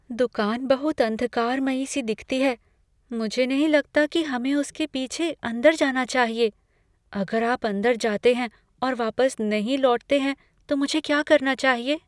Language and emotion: Hindi, fearful